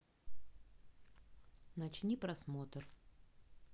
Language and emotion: Russian, neutral